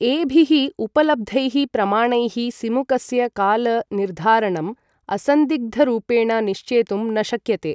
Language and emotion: Sanskrit, neutral